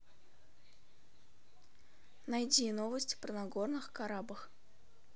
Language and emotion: Russian, neutral